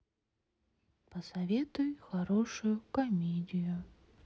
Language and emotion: Russian, sad